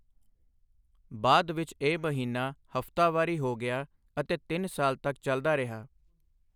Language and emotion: Punjabi, neutral